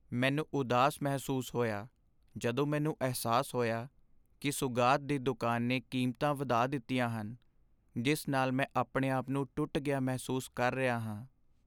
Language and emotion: Punjabi, sad